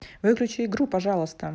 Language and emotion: Russian, neutral